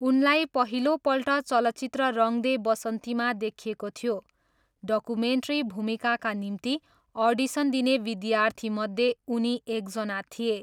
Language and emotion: Nepali, neutral